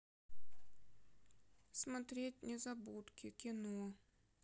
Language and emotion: Russian, sad